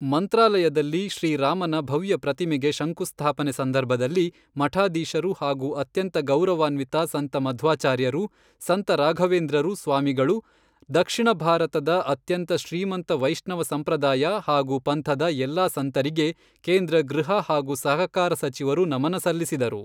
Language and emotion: Kannada, neutral